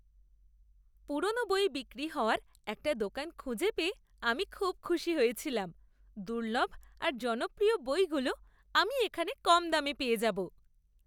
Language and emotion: Bengali, happy